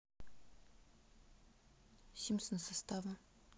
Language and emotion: Russian, neutral